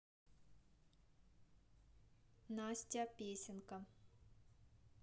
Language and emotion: Russian, neutral